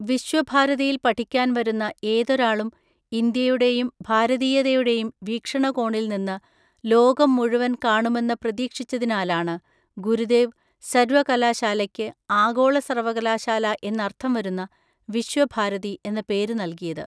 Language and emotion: Malayalam, neutral